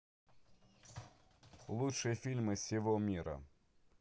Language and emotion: Russian, neutral